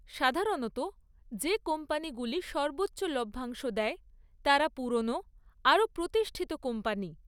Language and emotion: Bengali, neutral